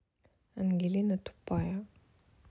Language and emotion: Russian, neutral